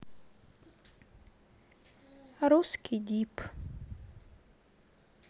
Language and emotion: Russian, sad